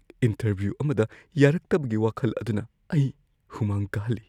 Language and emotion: Manipuri, fearful